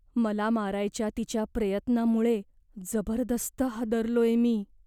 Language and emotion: Marathi, fearful